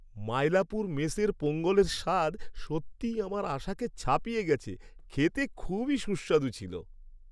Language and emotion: Bengali, happy